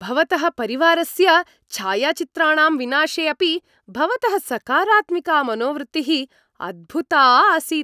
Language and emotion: Sanskrit, happy